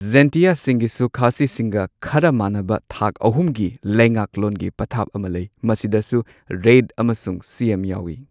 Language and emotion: Manipuri, neutral